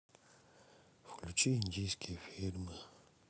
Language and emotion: Russian, sad